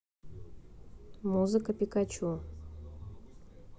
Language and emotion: Russian, neutral